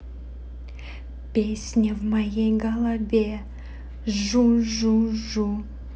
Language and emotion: Russian, positive